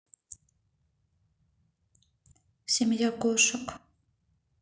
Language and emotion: Russian, neutral